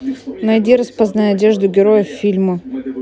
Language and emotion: Russian, neutral